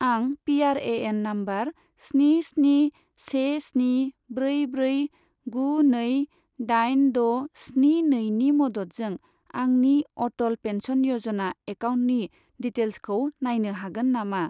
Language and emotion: Bodo, neutral